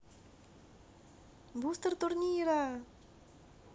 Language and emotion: Russian, positive